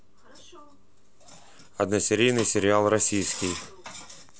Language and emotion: Russian, neutral